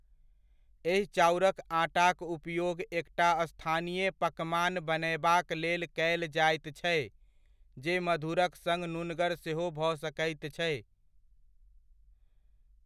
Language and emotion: Maithili, neutral